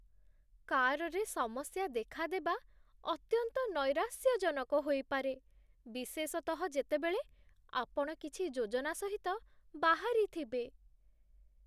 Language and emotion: Odia, sad